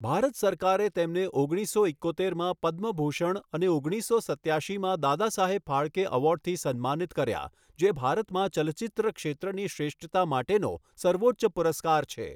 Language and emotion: Gujarati, neutral